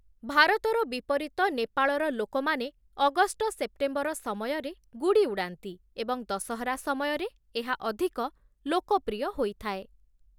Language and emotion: Odia, neutral